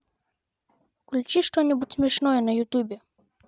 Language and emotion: Russian, neutral